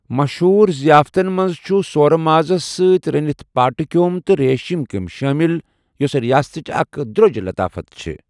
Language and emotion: Kashmiri, neutral